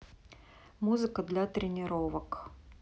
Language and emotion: Russian, neutral